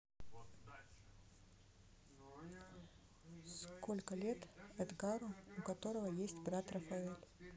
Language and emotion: Russian, neutral